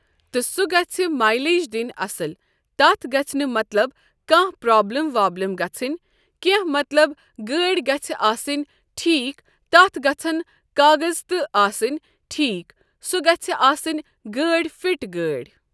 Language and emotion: Kashmiri, neutral